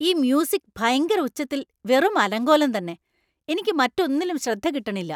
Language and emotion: Malayalam, angry